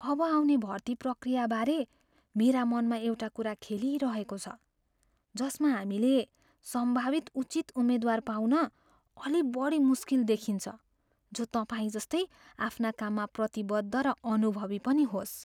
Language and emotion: Nepali, fearful